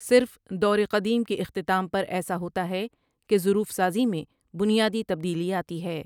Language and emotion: Urdu, neutral